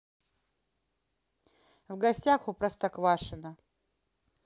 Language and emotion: Russian, neutral